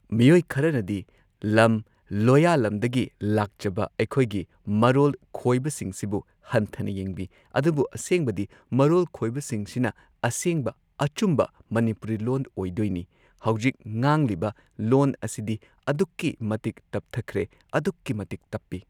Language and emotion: Manipuri, neutral